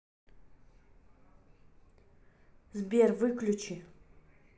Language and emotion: Russian, angry